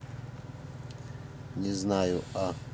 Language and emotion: Russian, neutral